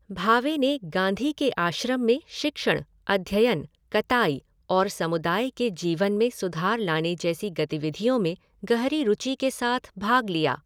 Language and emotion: Hindi, neutral